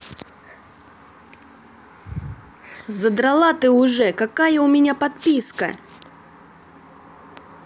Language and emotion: Russian, angry